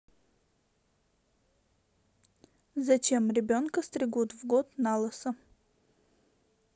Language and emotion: Russian, neutral